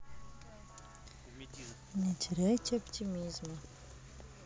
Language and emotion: Russian, neutral